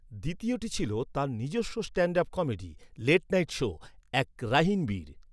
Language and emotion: Bengali, neutral